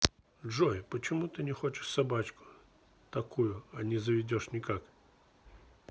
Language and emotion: Russian, neutral